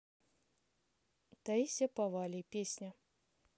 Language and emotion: Russian, neutral